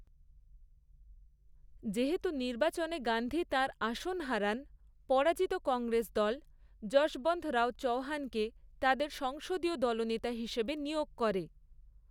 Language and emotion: Bengali, neutral